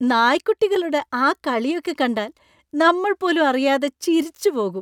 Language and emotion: Malayalam, happy